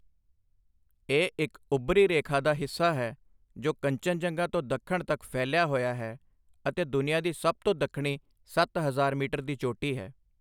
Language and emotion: Punjabi, neutral